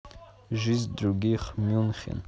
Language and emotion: Russian, neutral